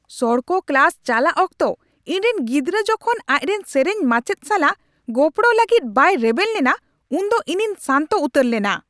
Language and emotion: Santali, angry